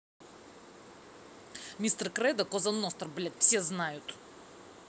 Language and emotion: Russian, angry